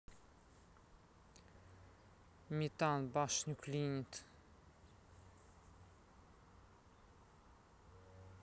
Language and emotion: Russian, neutral